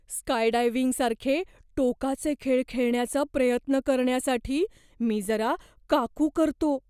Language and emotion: Marathi, fearful